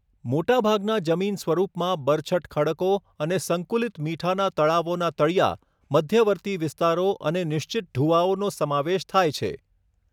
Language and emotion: Gujarati, neutral